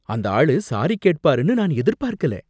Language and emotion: Tamil, surprised